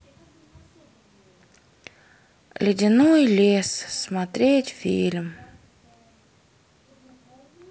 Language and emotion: Russian, sad